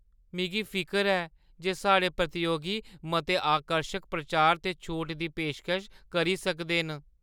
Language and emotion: Dogri, fearful